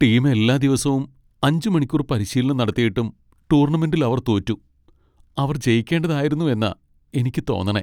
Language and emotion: Malayalam, sad